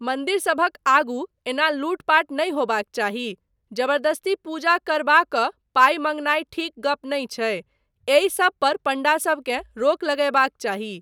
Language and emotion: Maithili, neutral